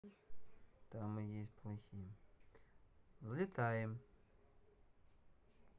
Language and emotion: Russian, neutral